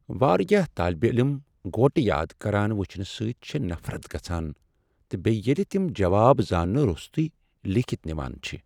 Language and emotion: Kashmiri, sad